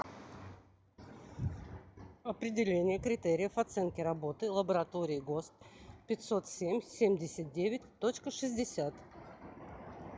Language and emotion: Russian, neutral